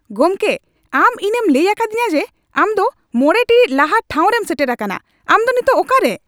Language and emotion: Santali, angry